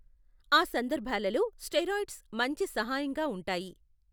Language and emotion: Telugu, neutral